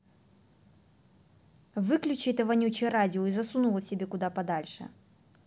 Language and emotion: Russian, angry